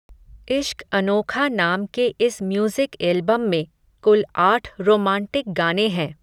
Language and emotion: Hindi, neutral